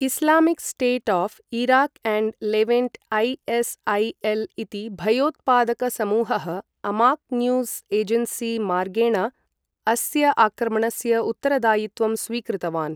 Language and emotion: Sanskrit, neutral